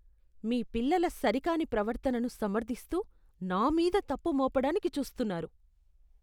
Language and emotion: Telugu, disgusted